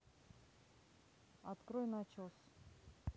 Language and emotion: Russian, neutral